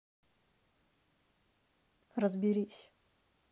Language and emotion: Russian, angry